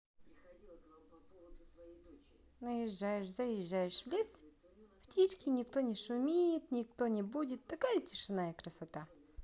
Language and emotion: Russian, positive